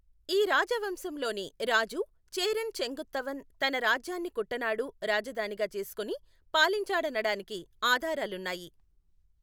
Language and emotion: Telugu, neutral